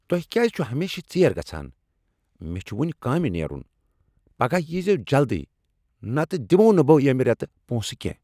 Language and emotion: Kashmiri, angry